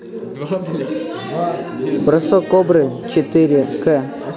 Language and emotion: Russian, neutral